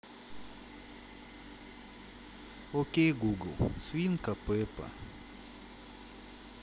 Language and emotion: Russian, sad